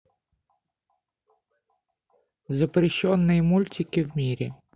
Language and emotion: Russian, neutral